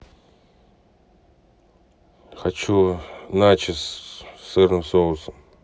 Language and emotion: Russian, neutral